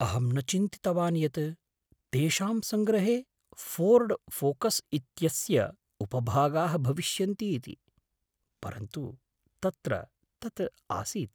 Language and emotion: Sanskrit, surprised